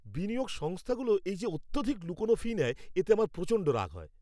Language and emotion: Bengali, angry